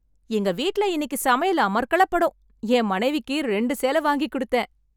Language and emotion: Tamil, happy